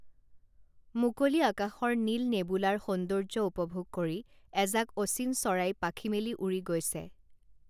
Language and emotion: Assamese, neutral